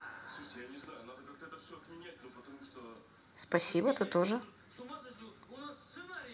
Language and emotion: Russian, neutral